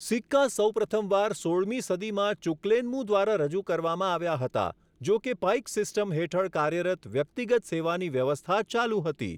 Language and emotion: Gujarati, neutral